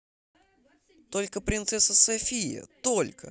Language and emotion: Russian, positive